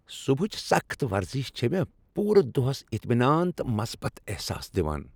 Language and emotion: Kashmiri, happy